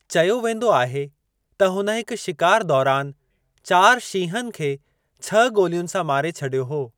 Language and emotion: Sindhi, neutral